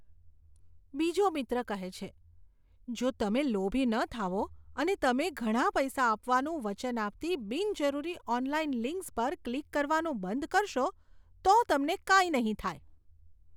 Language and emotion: Gujarati, disgusted